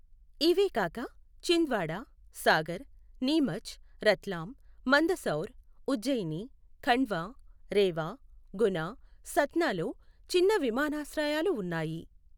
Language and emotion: Telugu, neutral